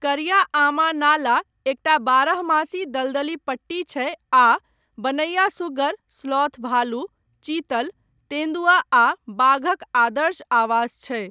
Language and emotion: Maithili, neutral